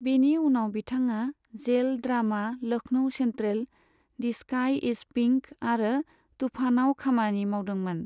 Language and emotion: Bodo, neutral